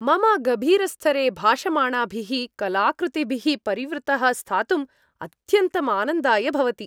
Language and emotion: Sanskrit, happy